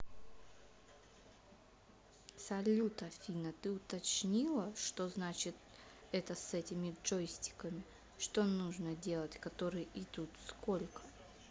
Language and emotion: Russian, neutral